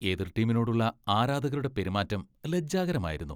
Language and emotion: Malayalam, disgusted